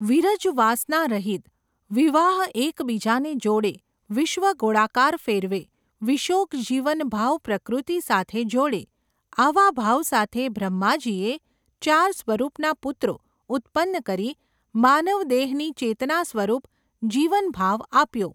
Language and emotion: Gujarati, neutral